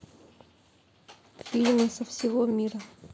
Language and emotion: Russian, neutral